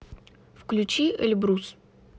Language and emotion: Russian, neutral